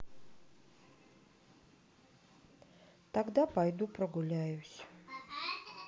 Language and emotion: Russian, sad